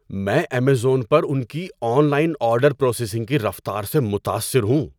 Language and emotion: Urdu, surprised